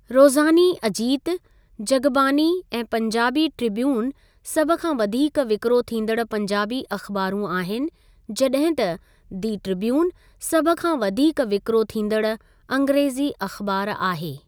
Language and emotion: Sindhi, neutral